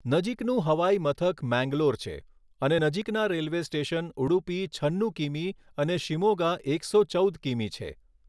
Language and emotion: Gujarati, neutral